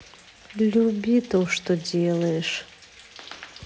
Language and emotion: Russian, sad